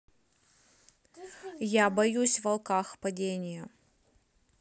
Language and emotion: Russian, neutral